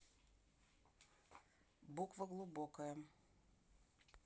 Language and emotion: Russian, neutral